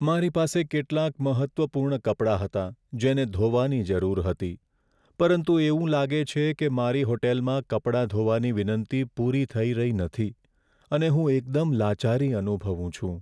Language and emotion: Gujarati, sad